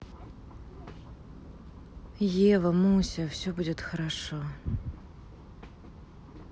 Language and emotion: Russian, sad